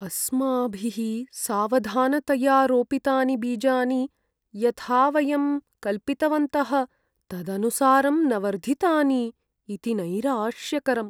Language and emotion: Sanskrit, sad